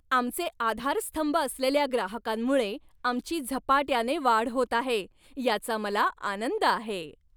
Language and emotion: Marathi, happy